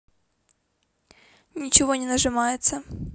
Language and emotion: Russian, neutral